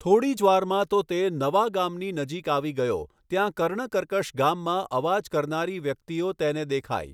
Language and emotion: Gujarati, neutral